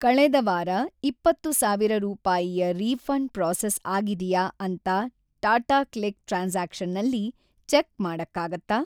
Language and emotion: Kannada, neutral